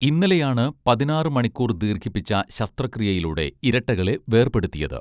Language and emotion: Malayalam, neutral